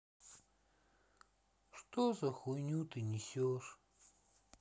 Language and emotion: Russian, sad